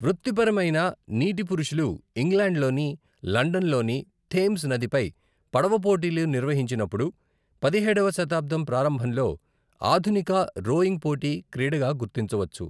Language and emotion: Telugu, neutral